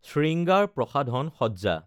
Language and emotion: Assamese, neutral